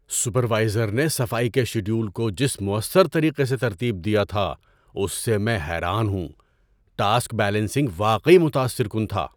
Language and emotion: Urdu, surprised